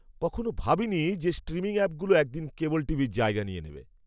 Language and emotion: Bengali, surprised